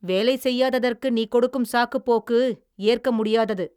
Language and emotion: Tamil, angry